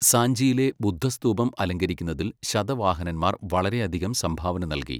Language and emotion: Malayalam, neutral